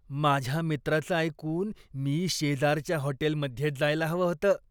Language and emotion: Marathi, disgusted